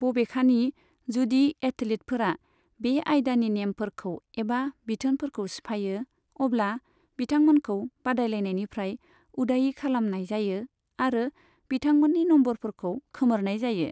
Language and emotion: Bodo, neutral